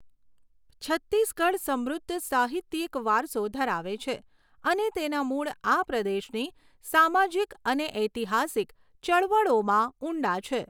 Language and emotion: Gujarati, neutral